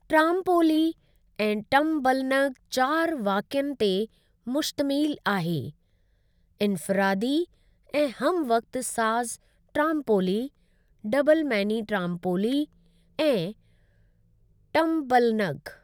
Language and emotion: Sindhi, neutral